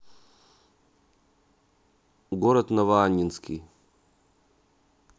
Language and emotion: Russian, neutral